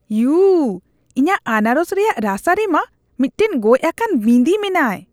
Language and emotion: Santali, disgusted